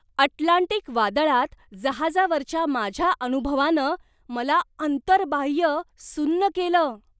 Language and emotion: Marathi, surprised